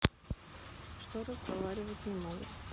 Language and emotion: Russian, neutral